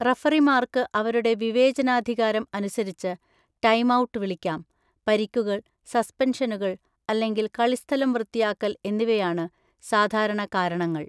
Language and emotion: Malayalam, neutral